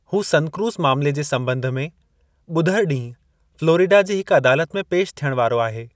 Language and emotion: Sindhi, neutral